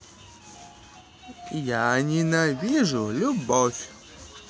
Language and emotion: Russian, neutral